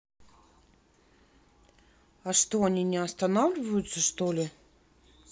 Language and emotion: Russian, neutral